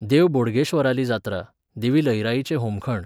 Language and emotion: Goan Konkani, neutral